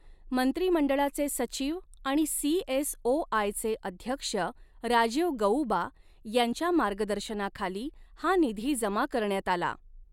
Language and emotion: Marathi, neutral